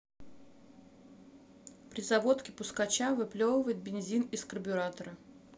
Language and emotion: Russian, neutral